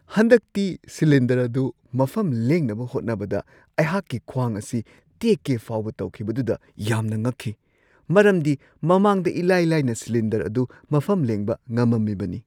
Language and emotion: Manipuri, surprised